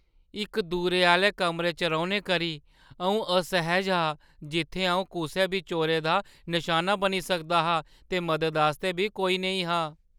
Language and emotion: Dogri, fearful